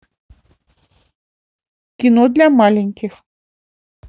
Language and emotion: Russian, neutral